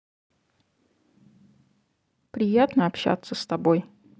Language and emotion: Russian, neutral